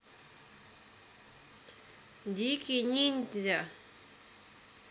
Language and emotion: Russian, neutral